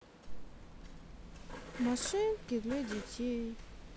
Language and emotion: Russian, sad